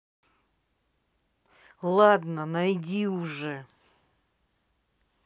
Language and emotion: Russian, angry